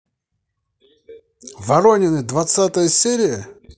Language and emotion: Russian, positive